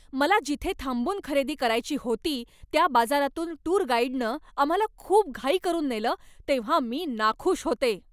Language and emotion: Marathi, angry